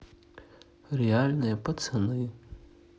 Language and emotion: Russian, sad